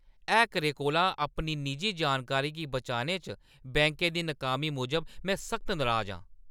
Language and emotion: Dogri, angry